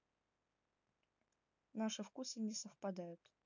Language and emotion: Russian, neutral